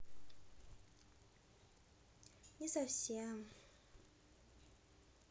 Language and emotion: Russian, sad